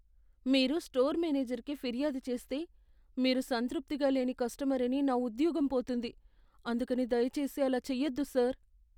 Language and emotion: Telugu, fearful